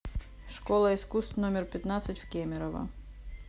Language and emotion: Russian, neutral